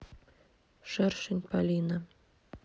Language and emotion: Russian, neutral